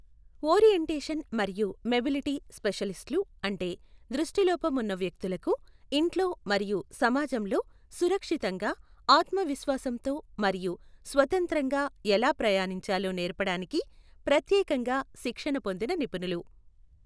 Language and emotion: Telugu, neutral